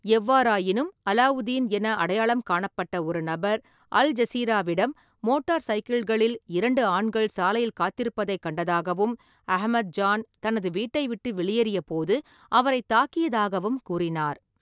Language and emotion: Tamil, neutral